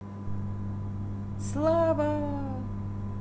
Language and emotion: Russian, positive